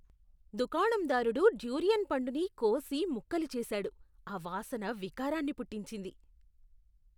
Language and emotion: Telugu, disgusted